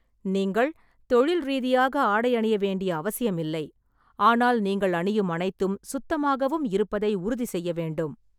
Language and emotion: Tamil, neutral